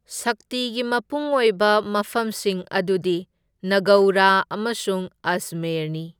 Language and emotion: Manipuri, neutral